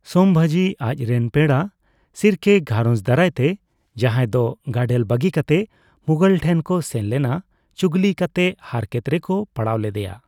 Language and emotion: Santali, neutral